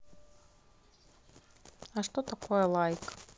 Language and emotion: Russian, neutral